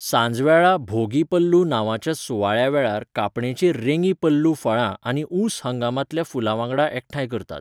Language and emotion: Goan Konkani, neutral